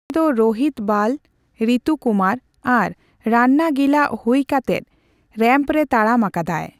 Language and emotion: Santali, neutral